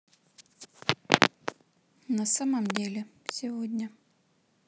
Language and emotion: Russian, neutral